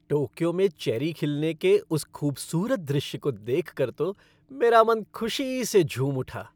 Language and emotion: Hindi, happy